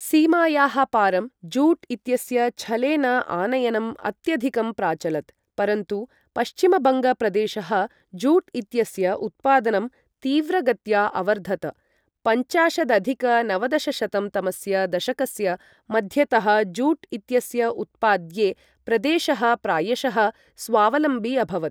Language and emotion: Sanskrit, neutral